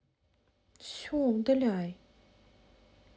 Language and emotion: Russian, angry